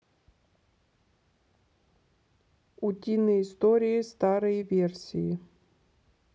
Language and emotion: Russian, neutral